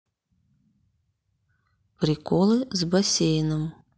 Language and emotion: Russian, neutral